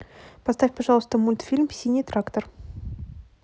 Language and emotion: Russian, neutral